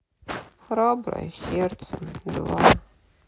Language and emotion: Russian, sad